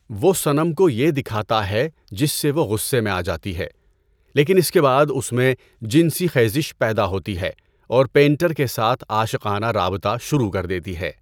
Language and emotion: Urdu, neutral